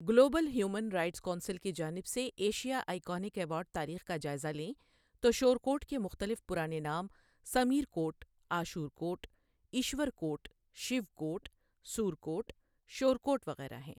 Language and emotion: Urdu, neutral